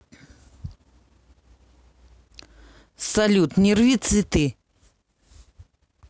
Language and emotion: Russian, neutral